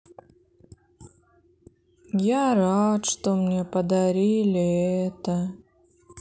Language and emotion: Russian, sad